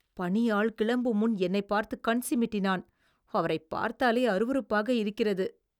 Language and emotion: Tamil, disgusted